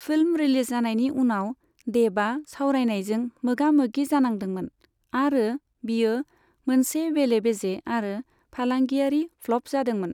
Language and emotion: Bodo, neutral